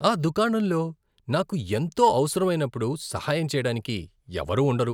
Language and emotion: Telugu, disgusted